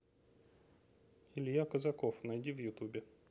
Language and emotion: Russian, neutral